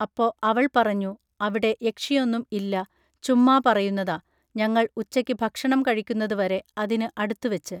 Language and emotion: Malayalam, neutral